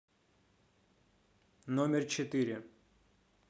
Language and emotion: Russian, neutral